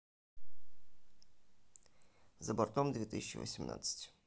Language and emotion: Russian, neutral